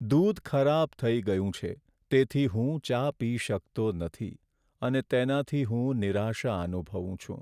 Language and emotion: Gujarati, sad